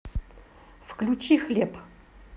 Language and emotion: Russian, neutral